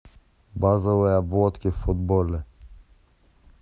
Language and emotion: Russian, neutral